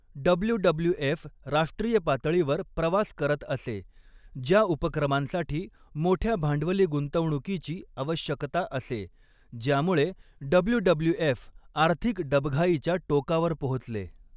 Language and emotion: Marathi, neutral